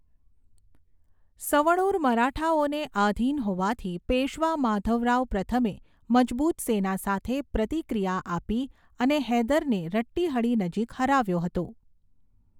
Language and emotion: Gujarati, neutral